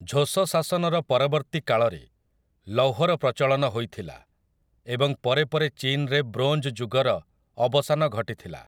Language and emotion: Odia, neutral